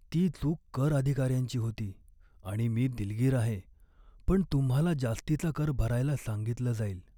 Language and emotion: Marathi, sad